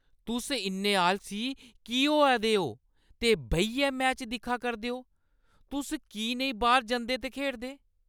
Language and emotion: Dogri, angry